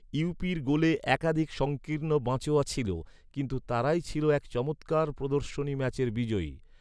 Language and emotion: Bengali, neutral